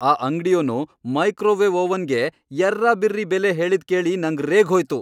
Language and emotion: Kannada, angry